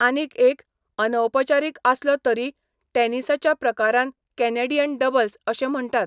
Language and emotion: Goan Konkani, neutral